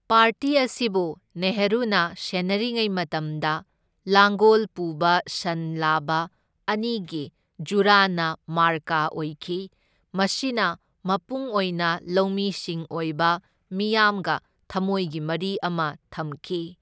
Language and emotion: Manipuri, neutral